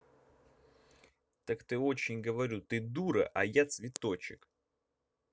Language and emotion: Russian, angry